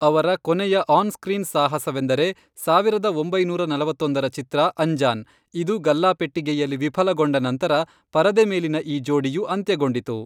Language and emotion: Kannada, neutral